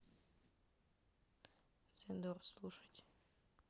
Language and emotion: Russian, neutral